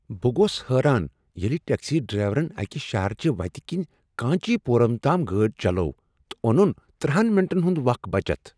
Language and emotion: Kashmiri, surprised